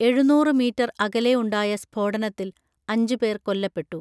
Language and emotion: Malayalam, neutral